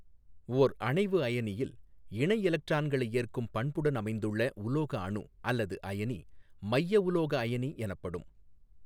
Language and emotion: Tamil, neutral